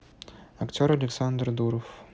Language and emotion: Russian, neutral